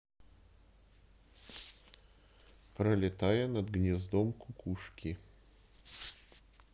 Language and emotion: Russian, neutral